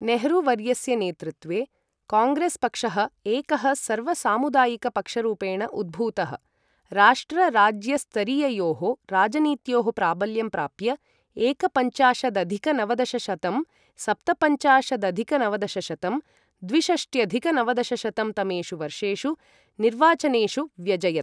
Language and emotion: Sanskrit, neutral